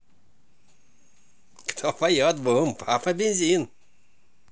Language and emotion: Russian, positive